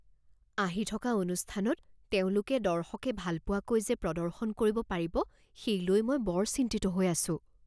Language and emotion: Assamese, fearful